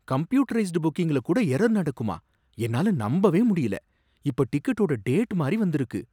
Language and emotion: Tamil, surprised